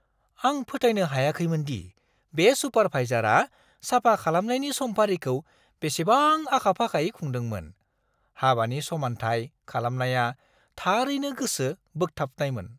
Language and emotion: Bodo, surprised